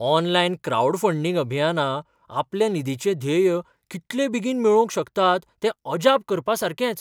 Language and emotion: Goan Konkani, surprised